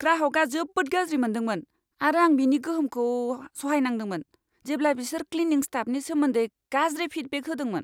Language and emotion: Bodo, angry